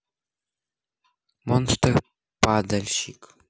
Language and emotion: Russian, neutral